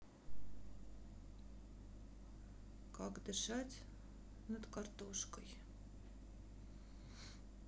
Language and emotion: Russian, sad